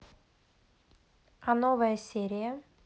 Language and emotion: Russian, neutral